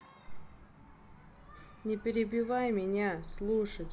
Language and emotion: Russian, angry